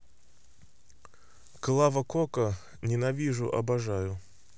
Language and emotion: Russian, neutral